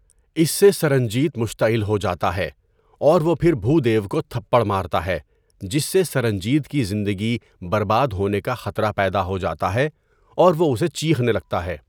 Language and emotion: Urdu, neutral